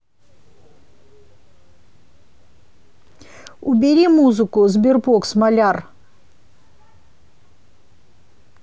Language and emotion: Russian, angry